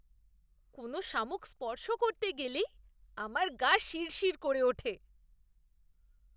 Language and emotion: Bengali, disgusted